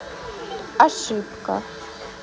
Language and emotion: Russian, neutral